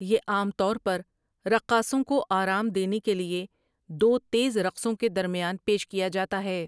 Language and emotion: Urdu, neutral